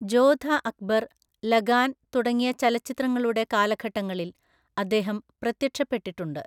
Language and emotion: Malayalam, neutral